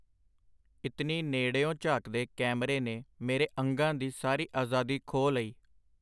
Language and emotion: Punjabi, neutral